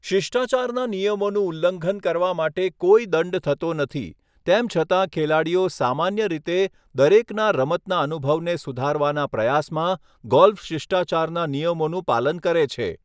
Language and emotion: Gujarati, neutral